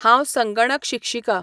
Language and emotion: Goan Konkani, neutral